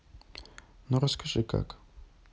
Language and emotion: Russian, neutral